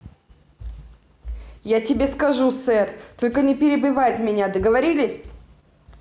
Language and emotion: Russian, angry